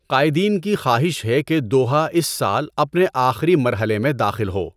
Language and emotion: Urdu, neutral